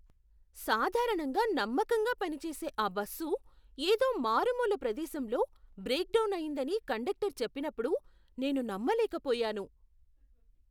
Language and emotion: Telugu, surprised